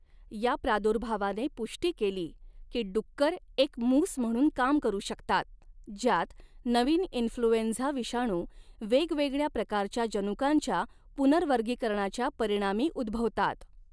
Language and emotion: Marathi, neutral